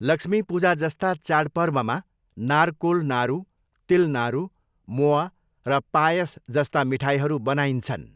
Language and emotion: Nepali, neutral